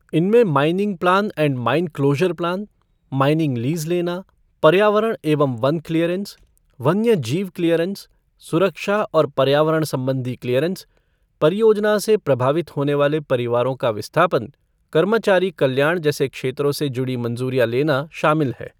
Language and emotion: Hindi, neutral